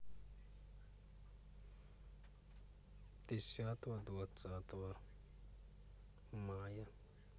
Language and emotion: Russian, neutral